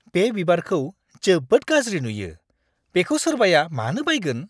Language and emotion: Bodo, disgusted